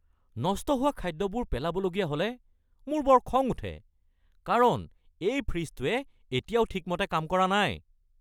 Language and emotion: Assamese, angry